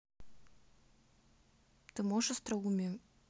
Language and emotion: Russian, neutral